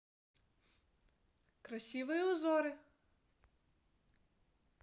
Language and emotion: Russian, positive